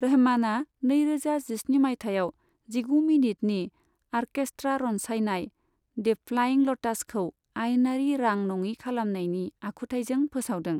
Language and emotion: Bodo, neutral